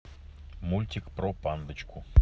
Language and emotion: Russian, neutral